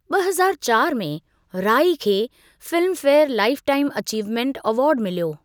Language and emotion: Sindhi, neutral